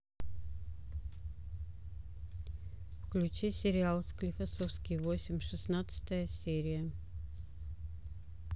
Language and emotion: Russian, neutral